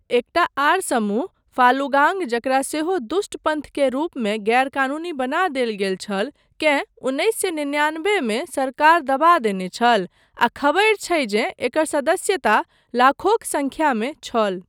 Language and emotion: Maithili, neutral